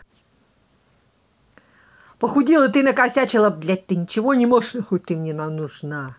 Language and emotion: Russian, angry